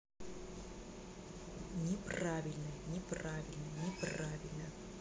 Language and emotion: Russian, angry